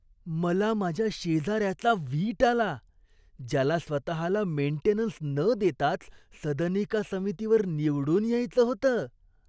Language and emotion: Marathi, disgusted